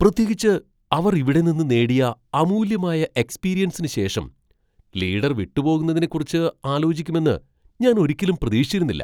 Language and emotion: Malayalam, surprised